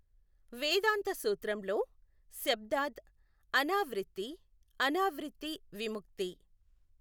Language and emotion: Telugu, neutral